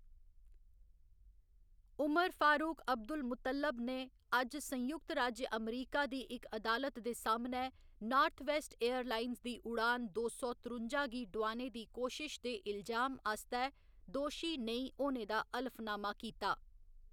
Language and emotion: Dogri, neutral